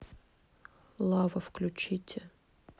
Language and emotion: Russian, neutral